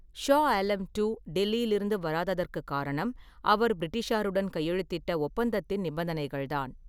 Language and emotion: Tamil, neutral